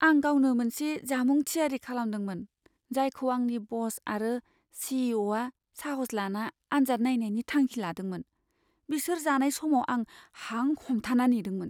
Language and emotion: Bodo, fearful